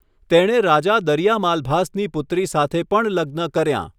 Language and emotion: Gujarati, neutral